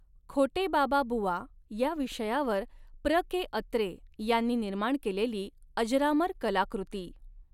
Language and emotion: Marathi, neutral